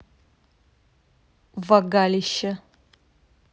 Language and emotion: Russian, neutral